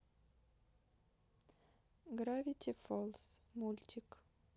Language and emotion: Russian, neutral